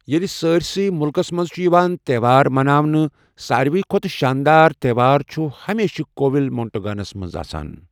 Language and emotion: Kashmiri, neutral